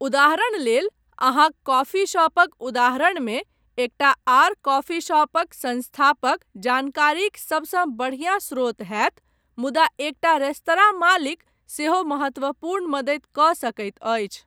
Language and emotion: Maithili, neutral